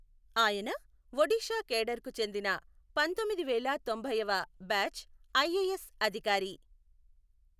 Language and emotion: Telugu, neutral